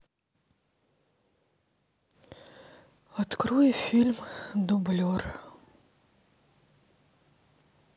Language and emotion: Russian, neutral